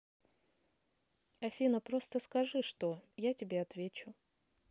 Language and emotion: Russian, neutral